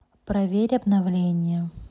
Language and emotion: Russian, neutral